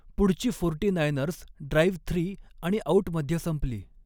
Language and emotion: Marathi, neutral